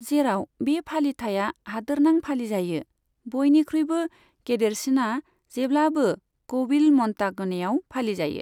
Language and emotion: Bodo, neutral